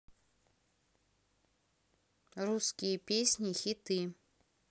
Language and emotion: Russian, neutral